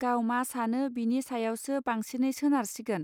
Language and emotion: Bodo, neutral